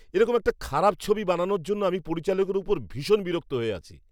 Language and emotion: Bengali, angry